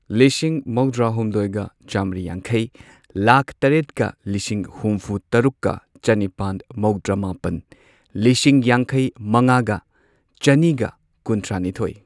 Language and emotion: Manipuri, neutral